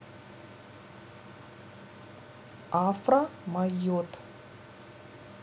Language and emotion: Russian, neutral